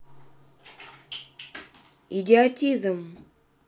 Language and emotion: Russian, neutral